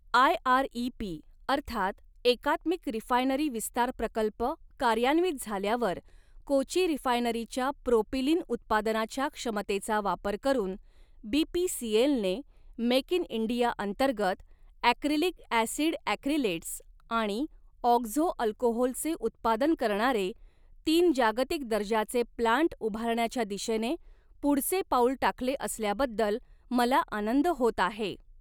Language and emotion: Marathi, neutral